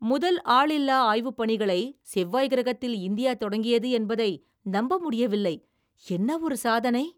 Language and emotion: Tamil, surprised